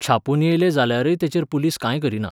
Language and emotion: Goan Konkani, neutral